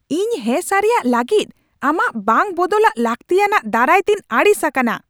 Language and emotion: Santali, angry